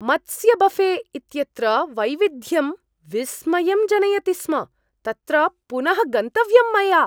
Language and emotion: Sanskrit, surprised